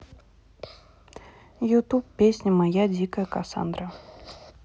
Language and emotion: Russian, neutral